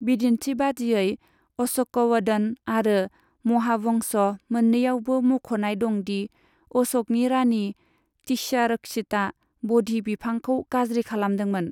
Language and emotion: Bodo, neutral